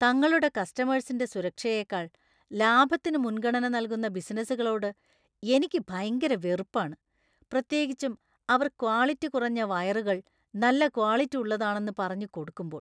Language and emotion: Malayalam, disgusted